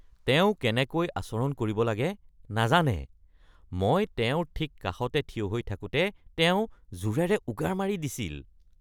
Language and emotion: Assamese, disgusted